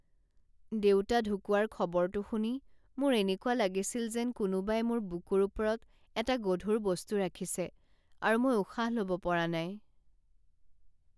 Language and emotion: Assamese, sad